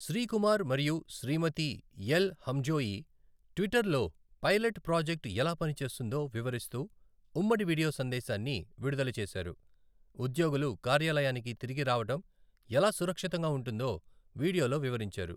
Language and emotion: Telugu, neutral